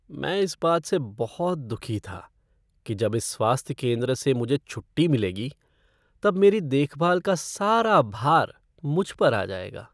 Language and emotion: Hindi, sad